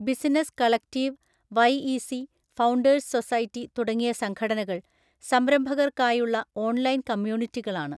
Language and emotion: Malayalam, neutral